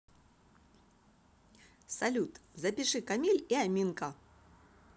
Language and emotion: Russian, positive